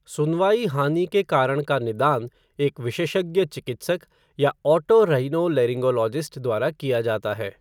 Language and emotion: Hindi, neutral